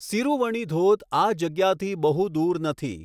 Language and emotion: Gujarati, neutral